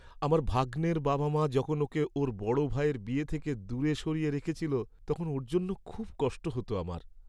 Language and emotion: Bengali, sad